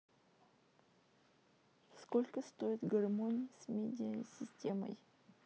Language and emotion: Russian, neutral